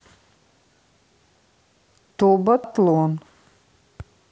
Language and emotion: Russian, neutral